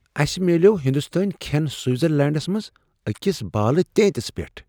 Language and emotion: Kashmiri, surprised